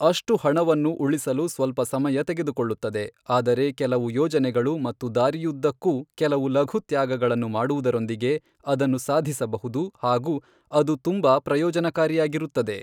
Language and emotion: Kannada, neutral